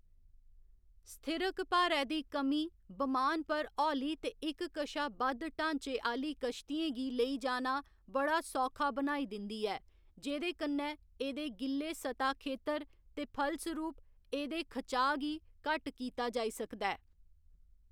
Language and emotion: Dogri, neutral